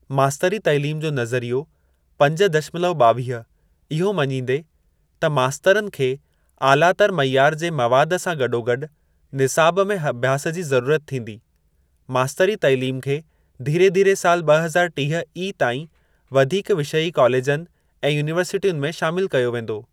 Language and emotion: Sindhi, neutral